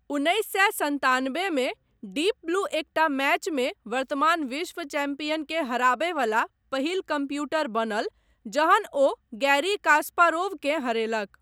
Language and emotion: Maithili, neutral